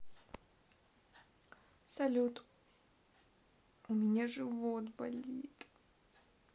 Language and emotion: Russian, sad